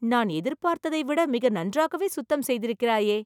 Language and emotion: Tamil, surprised